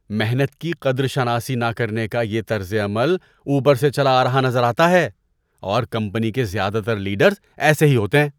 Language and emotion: Urdu, disgusted